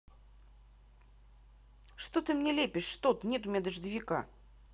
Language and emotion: Russian, angry